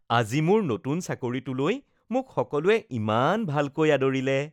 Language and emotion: Assamese, happy